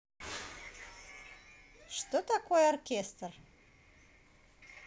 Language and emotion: Russian, positive